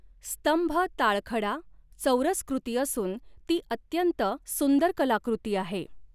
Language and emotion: Marathi, neutral